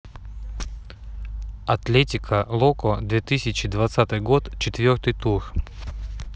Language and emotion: Russian, neutral